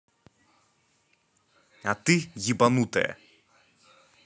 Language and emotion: Russian, angry